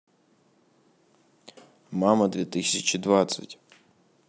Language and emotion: Russian, neutral